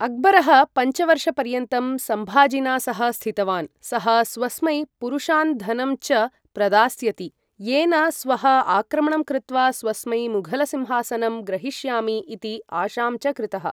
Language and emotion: Sanskrit, neutral